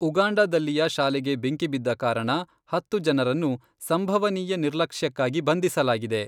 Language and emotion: Kannada, neutral